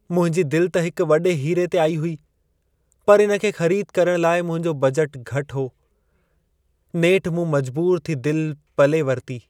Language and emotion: Sindhi, sad